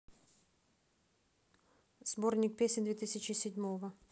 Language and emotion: Russian, neutral